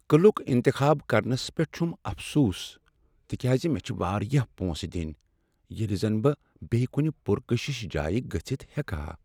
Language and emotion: Kashmiri, sad